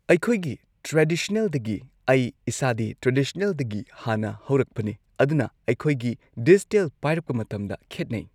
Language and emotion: Manipuri, neutral